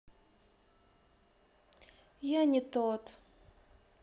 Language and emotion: Russian, sad